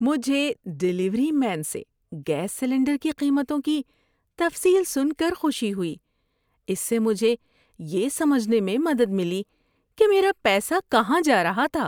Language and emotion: Urdu, happy